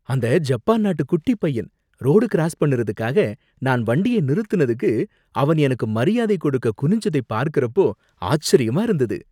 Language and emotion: Tamil, surprised